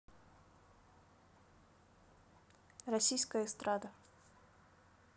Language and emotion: Russian, neutral